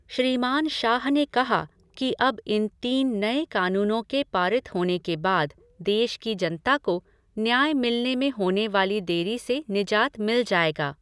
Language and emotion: Hindi, neutral